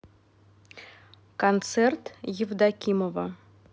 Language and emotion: Russian, neutral